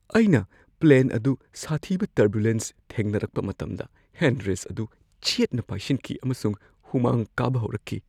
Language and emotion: Manipuri, fearful